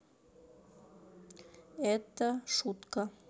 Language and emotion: Russian, neutral